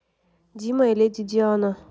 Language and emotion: Russian, neutral